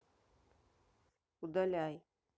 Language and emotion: Russian, neutral